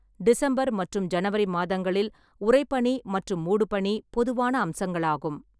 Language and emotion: Tamil, neutral